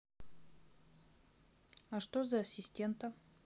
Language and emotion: Russian, neutral